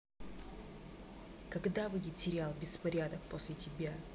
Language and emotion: Russian, angry